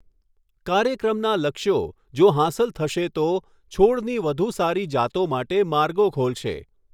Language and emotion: Gujarati, neutral